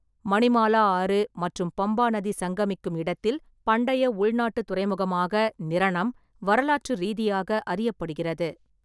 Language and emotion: Tamil, neutral